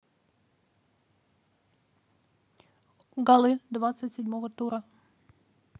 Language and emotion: Russian, neutral